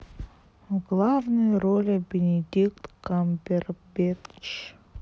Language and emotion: Russian, sad